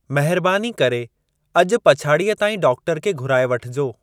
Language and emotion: Sindhi, neutral